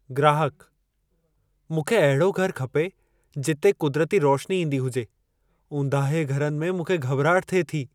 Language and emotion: Sindhi, fearful